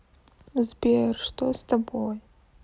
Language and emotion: Russian, sad